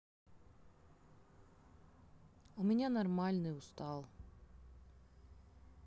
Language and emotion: Russian, sad